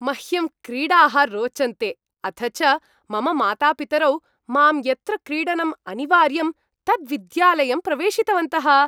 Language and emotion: Sanskrit, happy